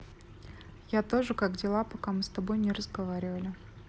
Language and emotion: Russian, neutral